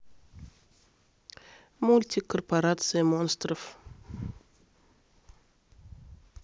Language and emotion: Russian, neutral